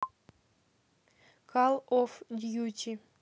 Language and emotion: Russian, neutral